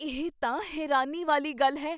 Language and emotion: Punjabi, surprised